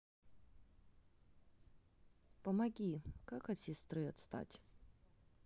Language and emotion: Russian, sad